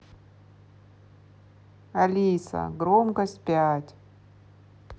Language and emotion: Russian, neutral